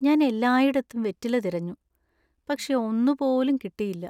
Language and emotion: Malayalam, sad